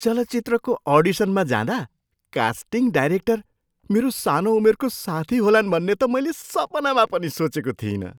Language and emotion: Nepali, surprised